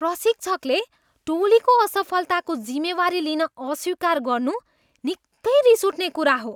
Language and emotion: Nepali, disgusted